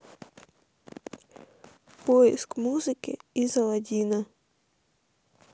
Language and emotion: Russian, sad